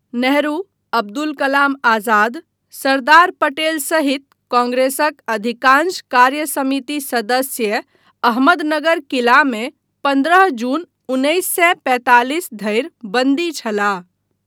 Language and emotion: Maithili, neutral